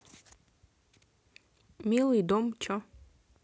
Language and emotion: Russian, neutral